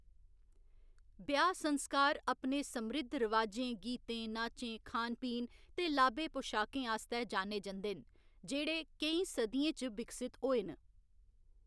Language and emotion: Dogri, neutral